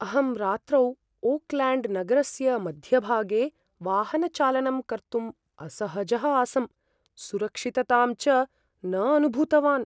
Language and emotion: Sanskrit, fearful